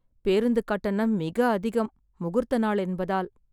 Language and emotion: Tamil, sad